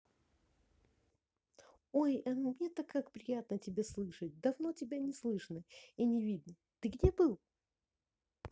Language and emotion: Russian, positive